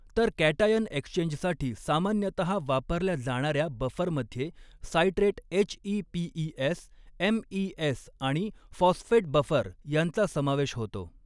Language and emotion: Marathi, neutral